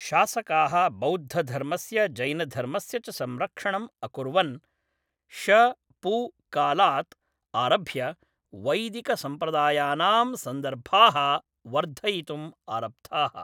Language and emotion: Sanskrit, neutral